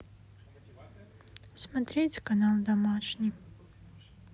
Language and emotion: Russian, sad